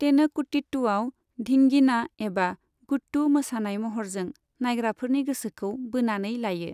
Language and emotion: Bodo, neutral